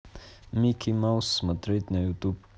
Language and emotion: Russian, neutral